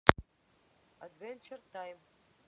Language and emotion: Russian, neutral